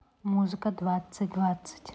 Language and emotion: Russian, neutral